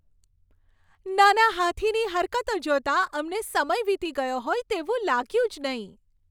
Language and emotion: Gujarati, happy